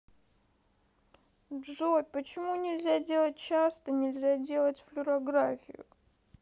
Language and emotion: Russian, sad